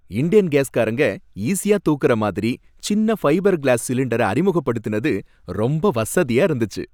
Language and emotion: Tamil, happy